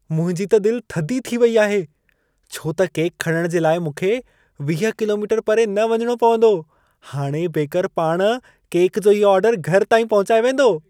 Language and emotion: Sindhi, happy